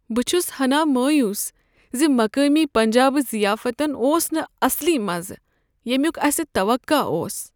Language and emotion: Kashmiri, sad